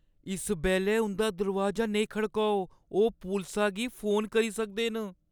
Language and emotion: Dogri, fearful